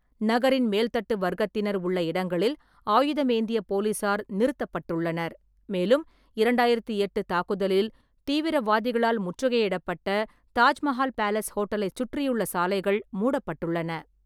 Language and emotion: Tamil, neutral